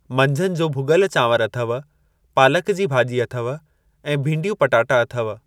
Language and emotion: Sindhi, neutral